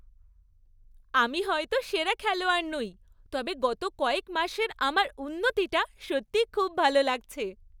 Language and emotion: Bengali, happy